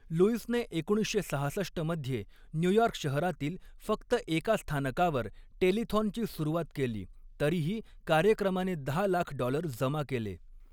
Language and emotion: Marathi, neutral